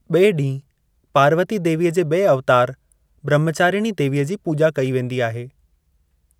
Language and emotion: Sindhi, neutral